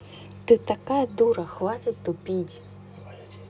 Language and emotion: Russian, angry